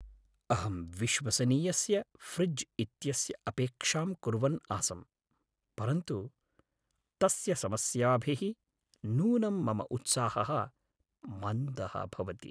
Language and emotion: Sanskrit, sad